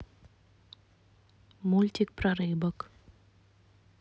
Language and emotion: Russian, neutral